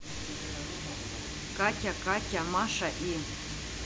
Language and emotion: Russian, neutral